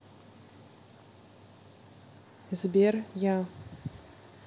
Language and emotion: Russian, neutral